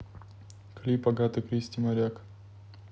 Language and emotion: Russian, neutral